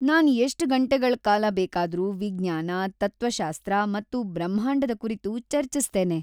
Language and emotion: Kannada, happy